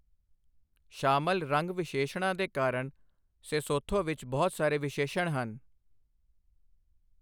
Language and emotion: Punjabi, neutral